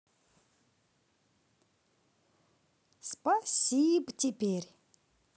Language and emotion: Russian, positive